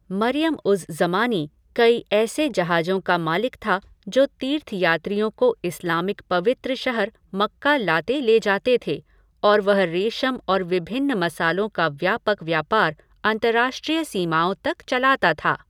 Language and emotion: Hindi, neutral